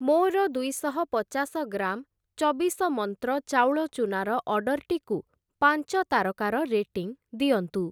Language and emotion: Odia, neutral